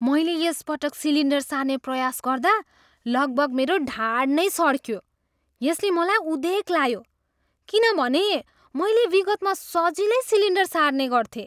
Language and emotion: Nepali, surprised